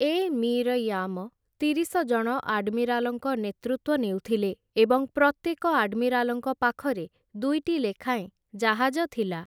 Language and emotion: Odia, neutral